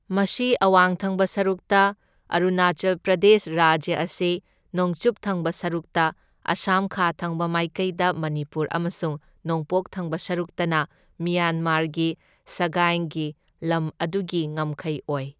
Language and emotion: Manipuri, neutral